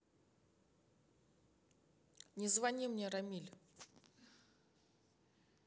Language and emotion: Russian, neutral